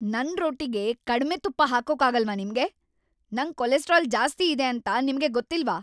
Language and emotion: Kannada, angry